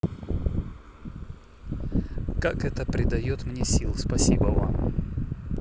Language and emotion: Russian, neutral